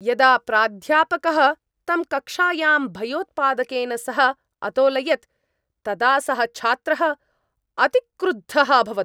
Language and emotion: Sanskrit, angry